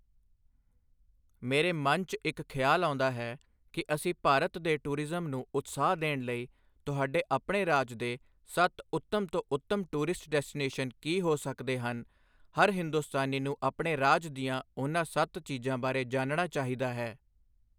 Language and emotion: Punjabi, neutral